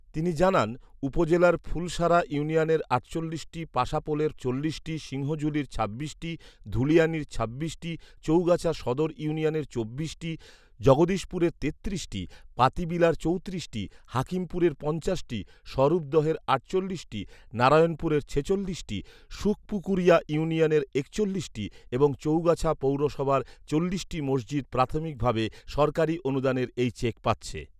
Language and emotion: Bengali, neutral